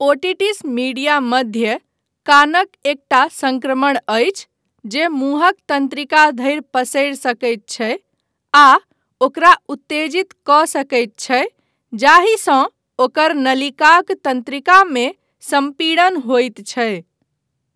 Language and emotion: Maithili, neutral